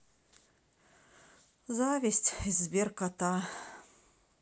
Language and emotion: Russian, sad